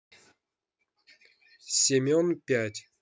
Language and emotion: Russian, neutral